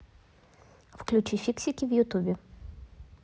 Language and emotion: Russian, neutral